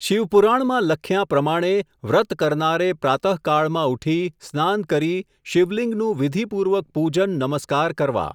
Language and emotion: Gujarati, neutral